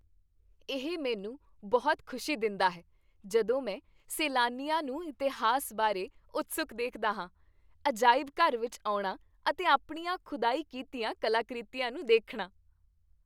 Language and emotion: Punjabi, happy